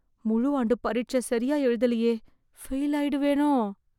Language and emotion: Tamil, fearful